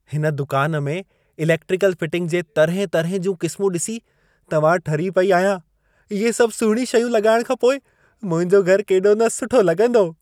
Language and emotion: Sindhi, happy